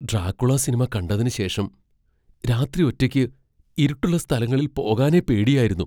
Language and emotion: Malayalam, fearful